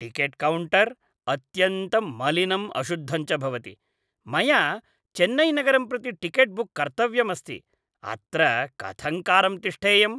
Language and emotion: Sanskrit, disgusted